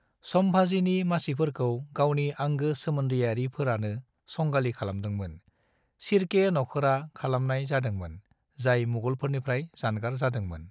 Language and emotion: Bodo, neutral